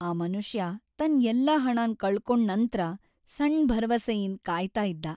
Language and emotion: Kannada, sad